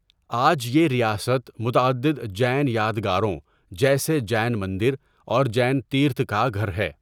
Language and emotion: Urdu, neutral